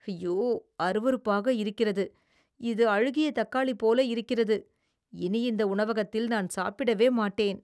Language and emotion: Tamil, disgusted